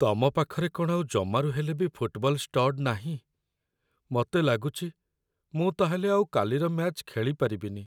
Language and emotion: Odia, sad